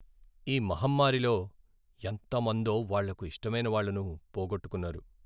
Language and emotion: Telugu, sad